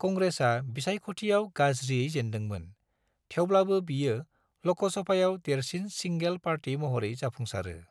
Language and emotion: Bodo, neutral